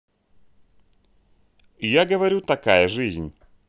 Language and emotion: Russian, neutral